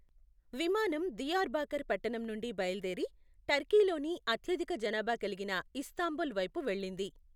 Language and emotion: Telugu, neutral